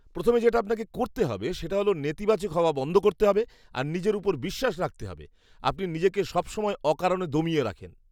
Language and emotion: Bengali, disgusted